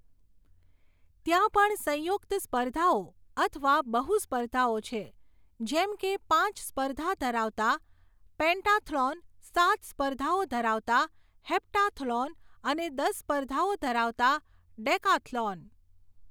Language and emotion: Gujarati, neutral